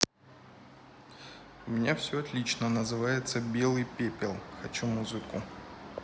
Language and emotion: Russian, neutral